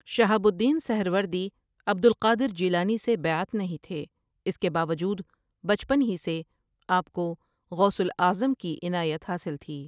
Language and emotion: Urdu, neutral